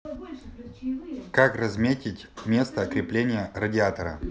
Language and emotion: Russian, neutral